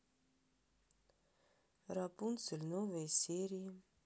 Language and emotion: Russian, neutral